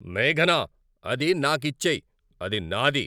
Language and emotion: Telugu, angry